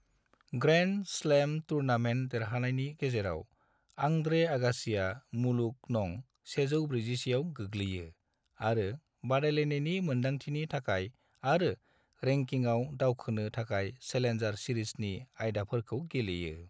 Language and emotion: Bodo, neutral